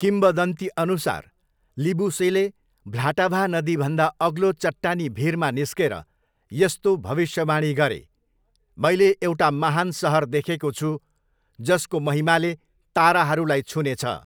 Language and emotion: Nepali, neutral